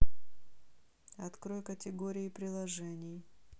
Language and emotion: Russian, neutral